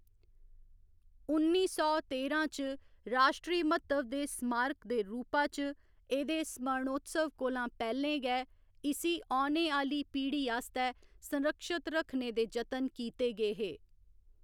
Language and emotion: Dogri, neutral